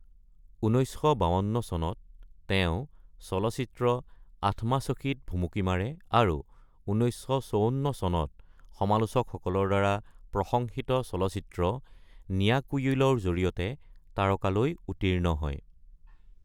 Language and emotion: Assamese, neutral